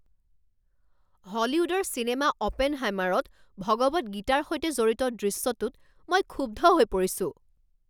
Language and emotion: Assamese, angry